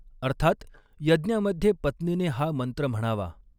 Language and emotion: Marathi, neutral